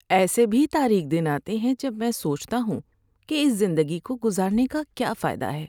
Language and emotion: Urdu, sad